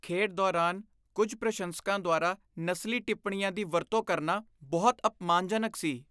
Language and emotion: Punjabi, disgusted